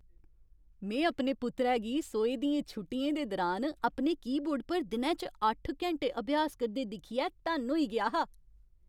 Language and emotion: Dogri, happy